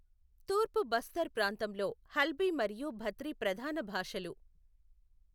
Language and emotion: Telugu, neutral